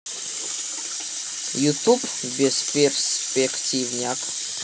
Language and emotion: Russian, neutral